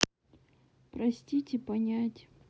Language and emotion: Russian, sad